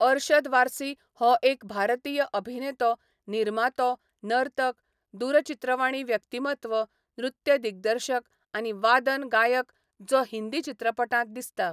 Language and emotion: Goan Konkani, neutral